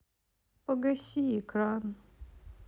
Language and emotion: Russian, sad